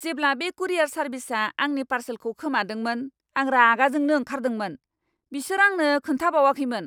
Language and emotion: Bodo, angry